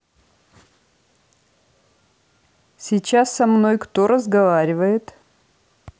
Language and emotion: Russian, neutral